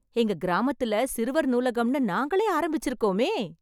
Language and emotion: Tamil, happy